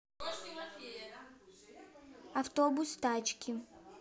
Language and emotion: Russian, neutral